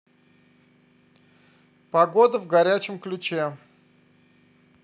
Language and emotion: Russian, positive